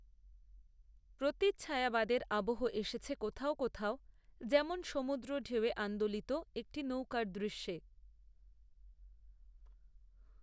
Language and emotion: Bengali, neutral